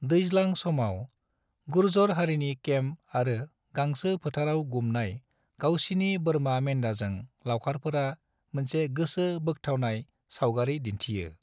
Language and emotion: Bodo, neutral